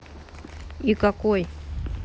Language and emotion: Russian, neutral